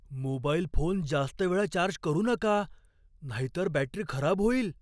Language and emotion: Marathi, fearful